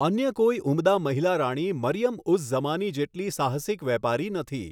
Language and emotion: Gujarati, neutral